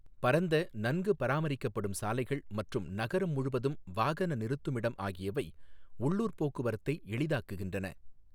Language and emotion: Tamil, neutral